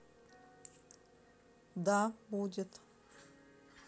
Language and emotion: Russian, neutral